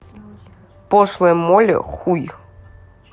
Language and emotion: Russian, neutral